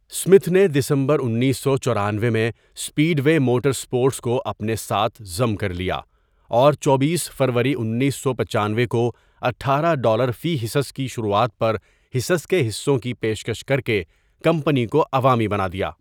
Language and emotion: Urdu, neutral